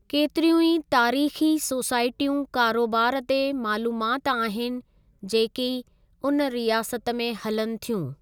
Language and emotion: Sindhi, neutral